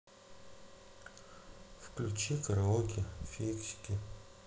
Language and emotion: Russian, sad